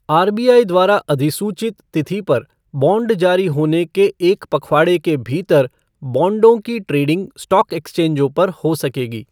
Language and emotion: Hindi, neutral